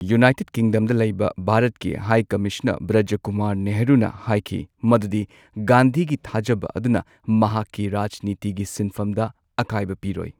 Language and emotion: Manipuri, neutral